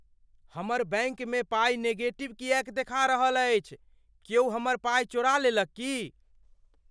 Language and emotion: Maithili, fearful